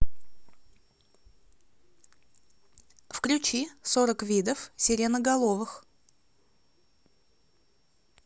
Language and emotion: Russian, neutral